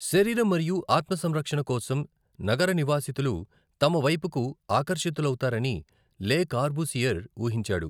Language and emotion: Telugu, neutral